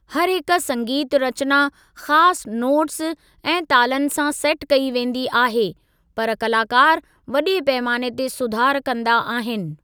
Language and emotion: Sindhi, neutral